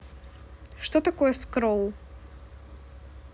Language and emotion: Russian, neutral